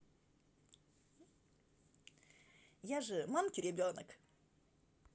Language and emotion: Russian, positive